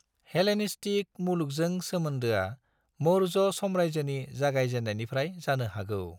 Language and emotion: Bodo, neutral